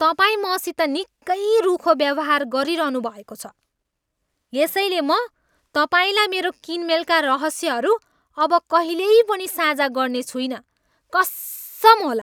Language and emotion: Nepali, angry